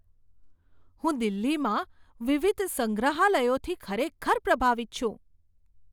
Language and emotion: Gujarati, surprised